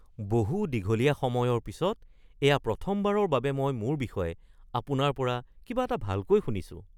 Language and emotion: Assamese, surprised